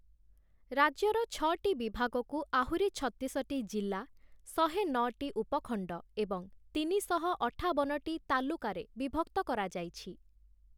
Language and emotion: Odia, neutral